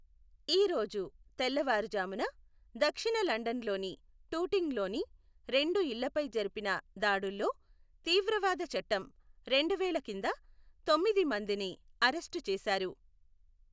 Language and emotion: Telugu, neutral